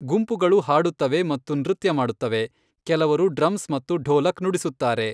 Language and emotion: Kannada, neutral